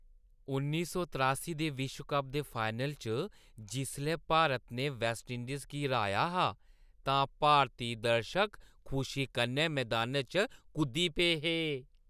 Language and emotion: Dogri, happy